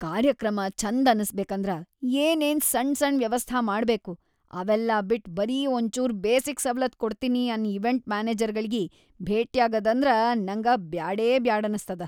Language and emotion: Kannada, disgusted